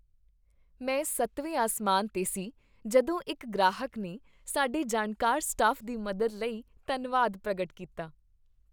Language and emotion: Punjabi, happy